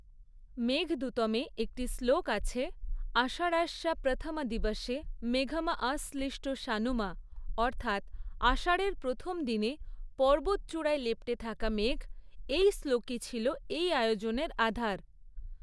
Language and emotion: Bengali, neutral